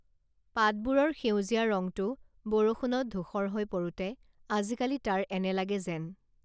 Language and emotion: Assamese, neutral